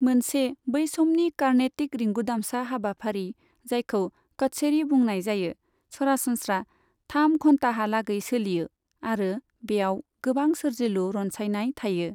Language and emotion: Bodo, neutral